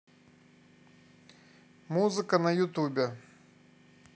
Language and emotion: Russian, neutral